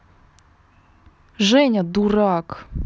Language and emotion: Russian, angry